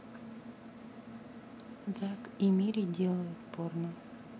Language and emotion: Russian, neutral